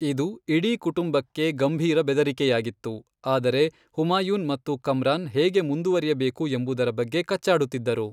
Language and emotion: Kannada, neutral